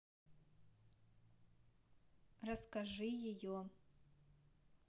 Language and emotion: Russian, neutral